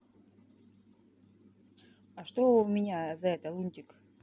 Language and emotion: Russian, neutral